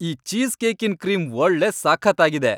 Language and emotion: Kannada, happy